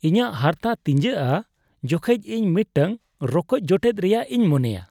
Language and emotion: Santali, disgusted